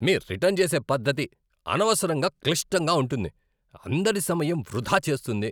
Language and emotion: Telugu, angry